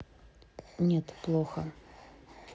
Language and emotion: Russian, neutral